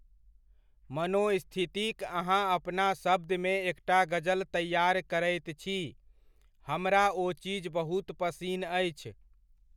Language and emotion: Maithili, neutral